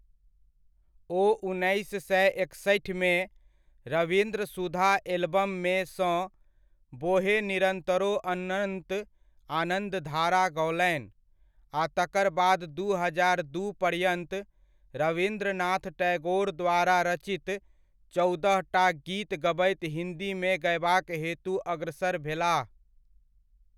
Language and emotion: Maithili, neutral